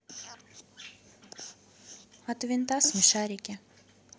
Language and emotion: Russian, neutral